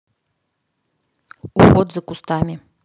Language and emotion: Russian, neutral